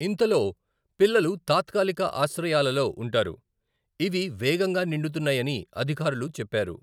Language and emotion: Telugu, neutral